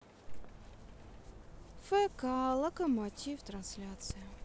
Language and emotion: Russian, sad